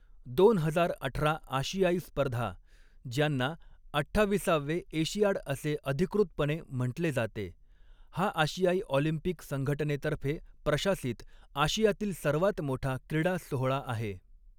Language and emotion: Marathi, neutral